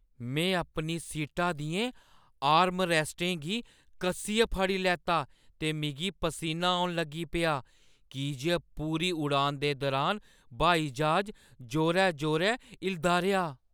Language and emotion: Dogri, fearful